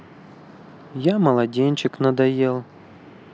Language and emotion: Russian, sad